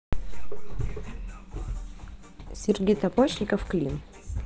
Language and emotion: Russian, neutral